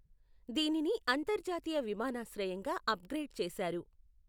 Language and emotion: Telugu, neutral